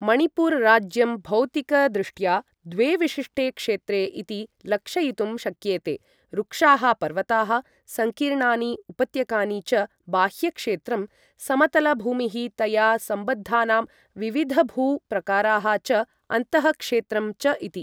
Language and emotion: Sanskrit, neutral